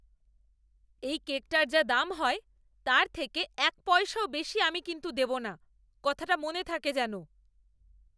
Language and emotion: Bengali, angry